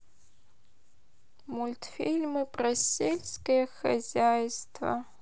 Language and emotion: Russian, sad